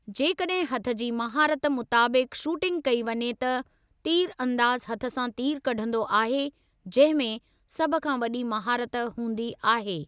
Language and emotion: Sindhi, neutral